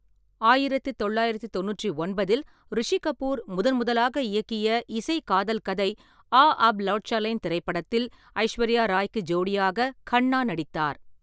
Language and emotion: Tamil, neutral